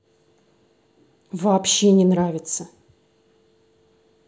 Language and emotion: Russian, angry